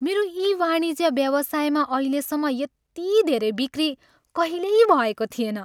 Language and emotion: Nepali, happy